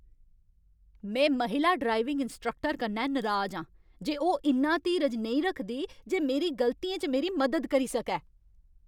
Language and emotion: Dogri, angry